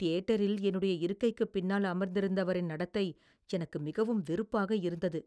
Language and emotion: Tamil, disgusted